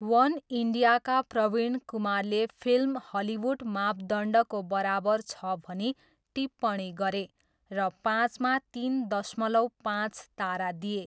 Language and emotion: Nepali, neutral